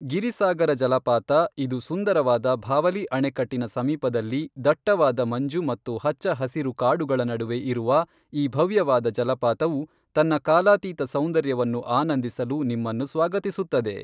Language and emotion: Kannada, neutral